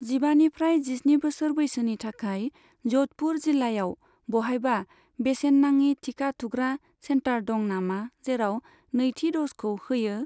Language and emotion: Bodo, neutral